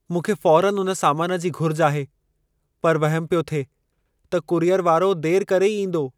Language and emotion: Sindhi, fearful